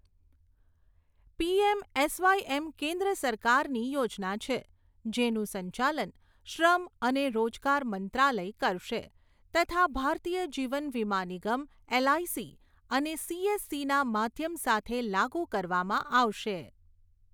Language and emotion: Gujarati, neutral